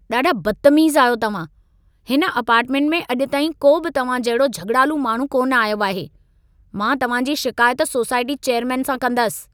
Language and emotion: Sindhi, angry